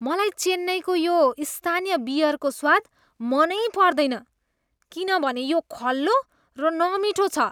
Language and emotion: Nepali, disgusted